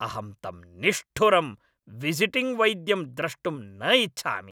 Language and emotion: Sanskrit, angry